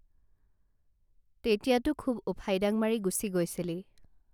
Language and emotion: Assamese, neutral